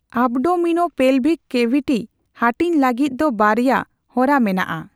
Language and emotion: Santali, neutral